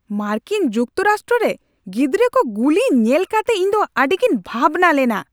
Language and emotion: Santali, angry